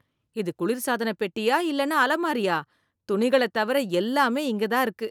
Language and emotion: Tamil, disgusted